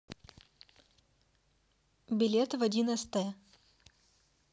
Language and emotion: Russian, neutral